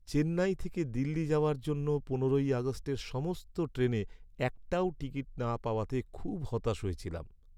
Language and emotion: Bengali, sad